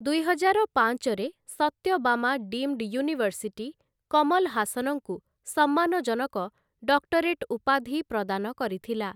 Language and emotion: Odia, neutral